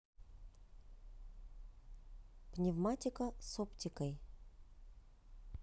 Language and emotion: Russian, neutral